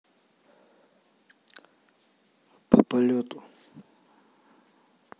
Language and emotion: Russian, neutral